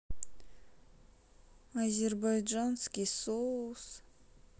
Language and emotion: Russian, sad